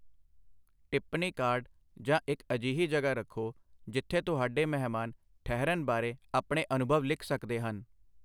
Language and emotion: Punjabi, neutral